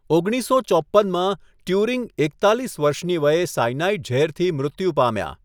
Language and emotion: Gujarati, neutral